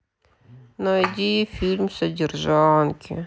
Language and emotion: Russian, sad